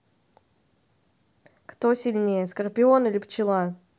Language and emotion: Russian, neutral